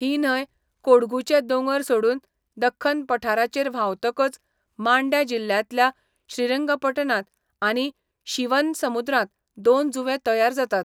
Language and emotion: Goan Konkani, neutral